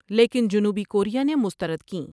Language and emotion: Urdu, neutral